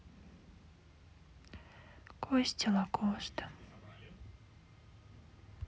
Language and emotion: Russian, sad